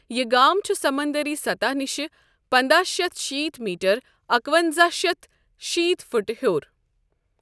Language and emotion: Kashmiri, neutral